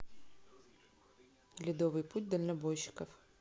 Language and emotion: Russian, neutral